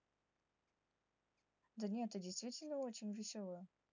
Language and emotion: Russian, neutral